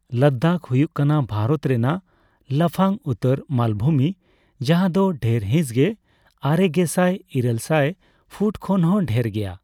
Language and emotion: Santali, neutral